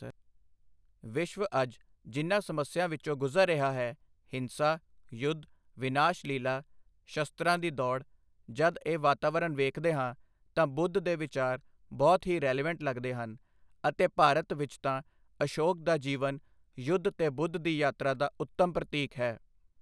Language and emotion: Punjabi, neutral